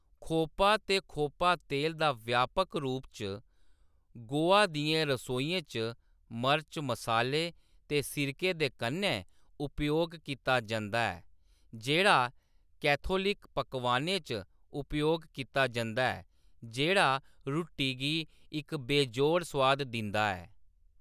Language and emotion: Dogri, neutral